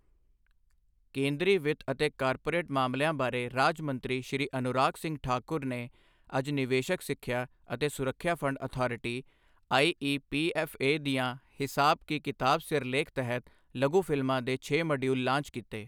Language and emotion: Punjabi, neutral